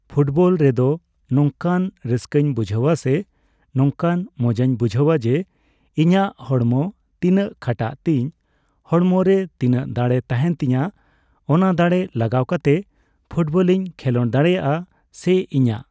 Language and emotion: Santali, neutral